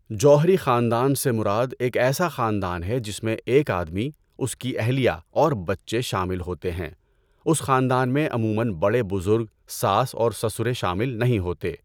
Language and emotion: Urdu, neutral